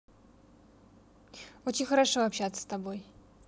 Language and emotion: Russian, neutral